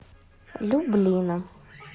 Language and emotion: Russian, neutral